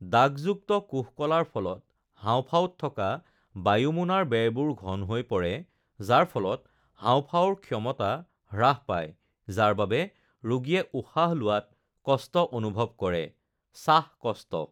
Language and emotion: Assamese, neutral